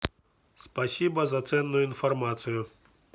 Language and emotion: Russian, neutral